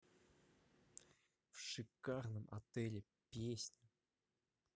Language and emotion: Russian, neutral